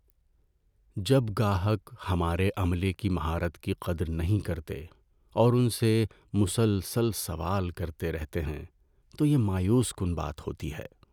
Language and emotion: Urdu, sad